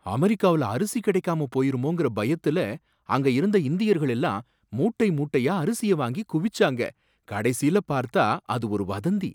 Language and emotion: Tamil, surprised